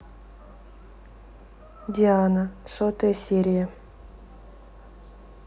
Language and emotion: Russian, neutral